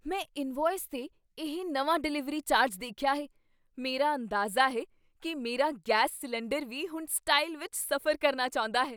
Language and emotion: Punjabi, surprised